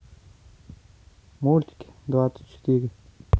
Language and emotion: Russian, neutral